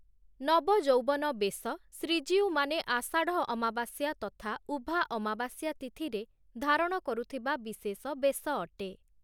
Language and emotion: Odia, neutral